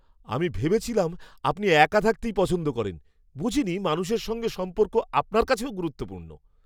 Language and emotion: Bengali, surprised